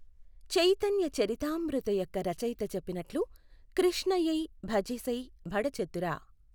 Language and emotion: Telugu, neutral